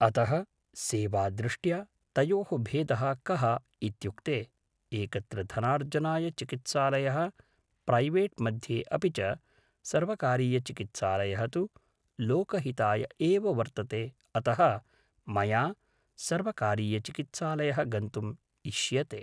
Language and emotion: Sanskrit, neutral